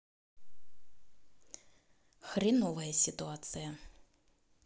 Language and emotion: Russian, angry